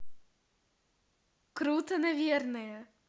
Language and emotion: Russian, positive